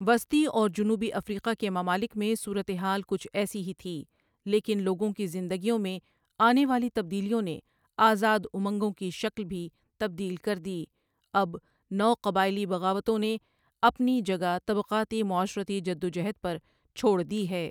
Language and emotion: Urdu, neutral